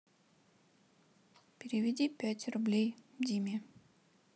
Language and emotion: Russian, sad